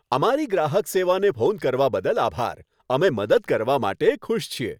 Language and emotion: Gujarati, happy